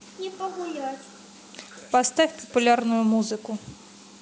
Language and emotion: Russian, neutral